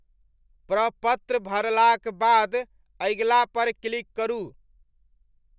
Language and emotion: Maithili, neutral